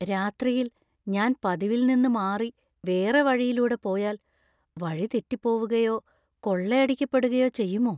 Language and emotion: Malayalam, fearful